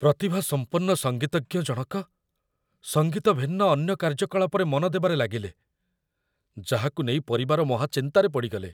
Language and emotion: Odia, fearful